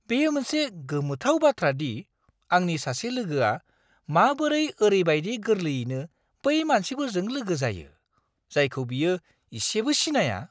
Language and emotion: Bodo, surprised